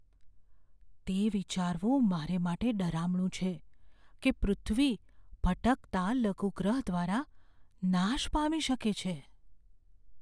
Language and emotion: Gujarati, fearful